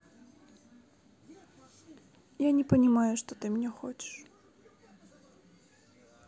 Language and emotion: Russian, sad